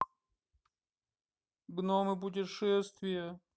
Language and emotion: Russian, sad